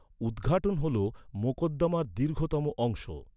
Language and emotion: Bengali, neutral